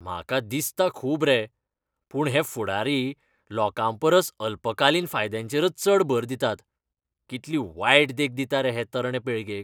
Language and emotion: Goan Konkani, disgusted